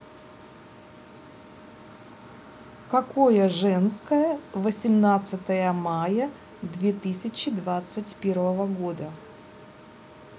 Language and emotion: Russian, neutral